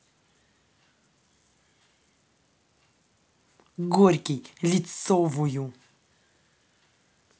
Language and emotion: Russian, angry